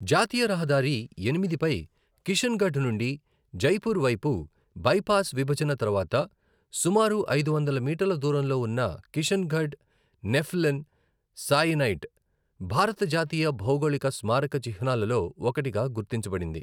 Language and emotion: Telugu, neutral